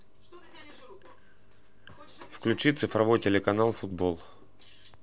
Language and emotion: Russian, neutral